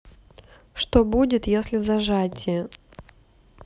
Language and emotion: Russian, neutral